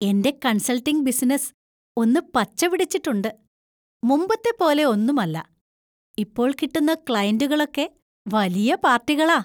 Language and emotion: Malayalam, happy